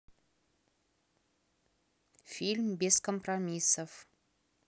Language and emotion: Russian, neutral